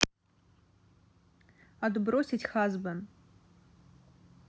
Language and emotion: Russian, neutral